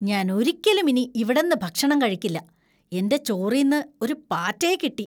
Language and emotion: Malayalam, disgusted